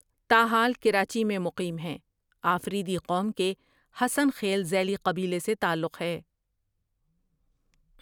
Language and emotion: Urdu, neutral